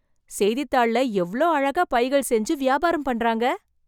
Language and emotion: Tamil, surprised